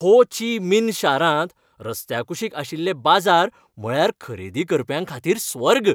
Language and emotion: Goan Konkani, happy